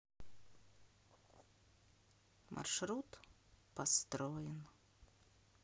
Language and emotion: Russian, sad